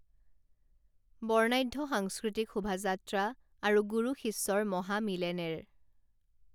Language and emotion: Assamese, neutral